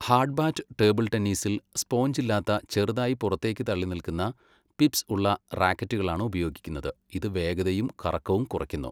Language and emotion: Malayalam, neutral